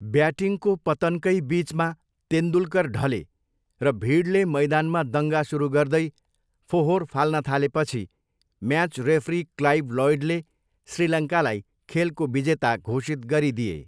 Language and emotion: Nepali, neutral